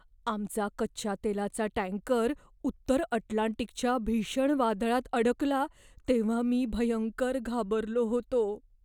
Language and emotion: Marathi, fearful